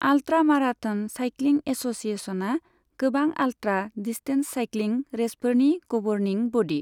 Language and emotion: Bodo, neutral